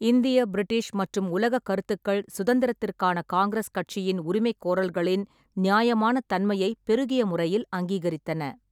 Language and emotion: Tamil, neutral